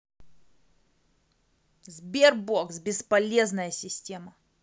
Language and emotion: Russian, angry